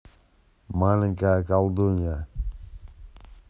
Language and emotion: Russian, neutral